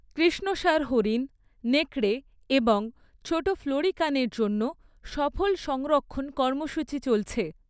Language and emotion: Bengali, neutral